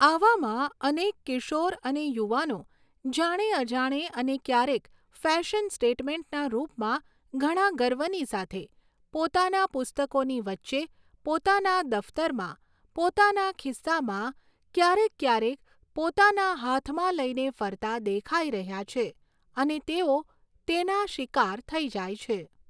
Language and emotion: Gujarati, neutral